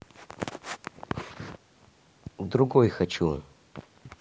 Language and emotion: Russian, neutral